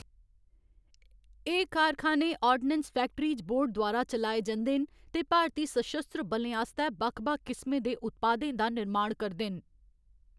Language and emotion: Dogri, neutral